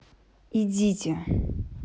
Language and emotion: Russian, neutral